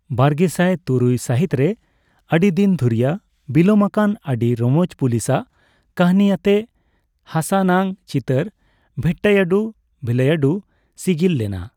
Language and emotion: Santali, neutral